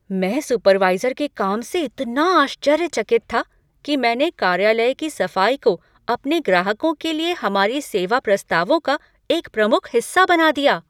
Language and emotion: Hindi, surprised